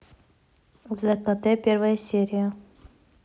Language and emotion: Russian, neutral